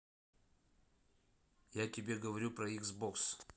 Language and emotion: Russian, neutral